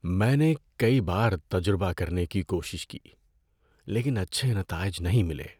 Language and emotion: Urdu, sad